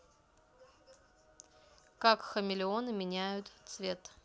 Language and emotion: Russian, neutral